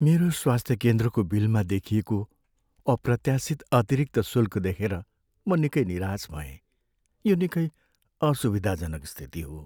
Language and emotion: Nepali, sad